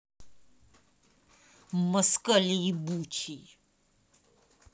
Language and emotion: Russian, angry